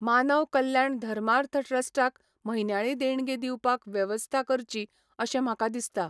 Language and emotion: Goan Konkani, neutral